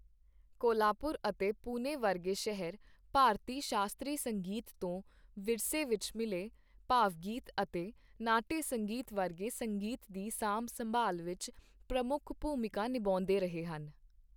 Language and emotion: Punjabi, neutral